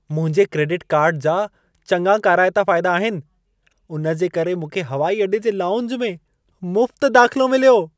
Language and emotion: Sindhi, happy